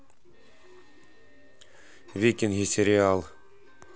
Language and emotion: Russian, neutral